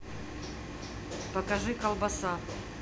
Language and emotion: Russian, neutral